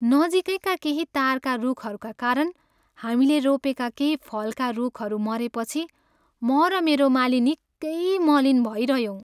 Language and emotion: Nepali, sad